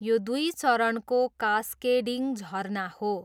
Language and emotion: Nepali, neutral